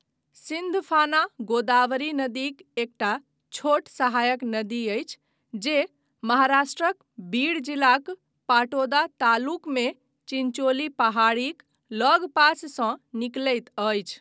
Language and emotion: Maithili, neutral